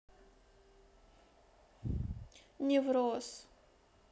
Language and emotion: Russian, sad